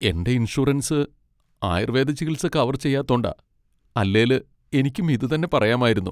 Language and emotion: Malayalam, sad